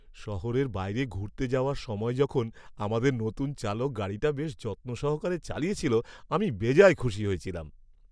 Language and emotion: Bengali, happy